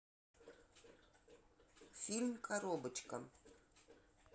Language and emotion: Russian, neutral